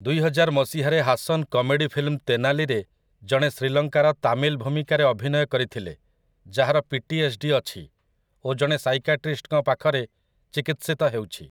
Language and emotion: Odia, neutral